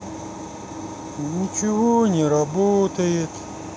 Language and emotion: Russian, sad